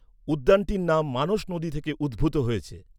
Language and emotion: Bengali, neutral